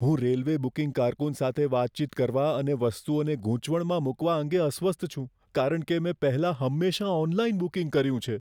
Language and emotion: Gujarati, fearful